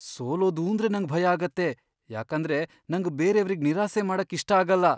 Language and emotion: Kannada, fearful